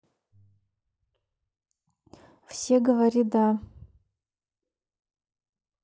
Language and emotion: Russian, neutral